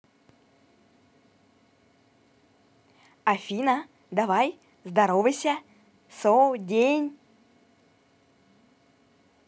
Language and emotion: Russian, positive